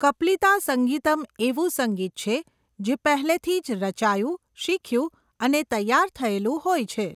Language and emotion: Gujarati, neutral